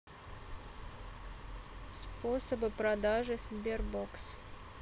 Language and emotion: Russian, neutral